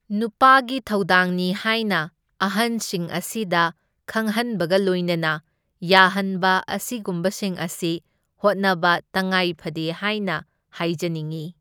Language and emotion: Manipuri, neutral